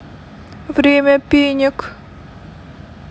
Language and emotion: Russian, sad